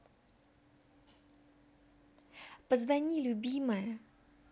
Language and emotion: Russian, positive